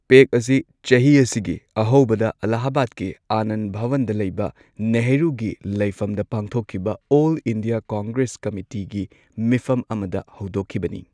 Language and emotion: Manipuri, neutral